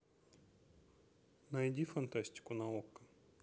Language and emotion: Russian, neutral